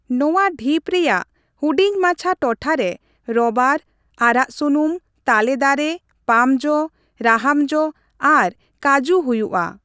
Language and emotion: Santali, neutral